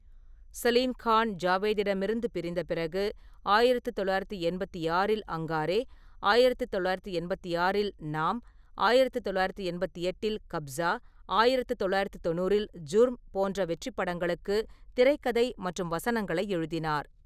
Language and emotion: Tamil, neutral